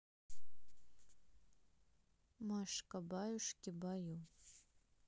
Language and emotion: Russian, neutral